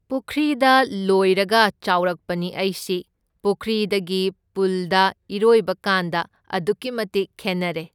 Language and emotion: Manipuri, neutral